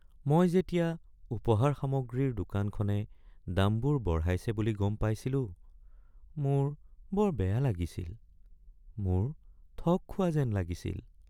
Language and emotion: Assamese, sad